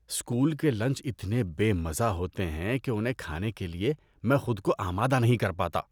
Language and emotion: Urdu, disgusted